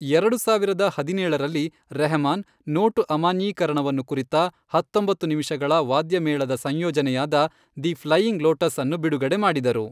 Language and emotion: Kannada, neutral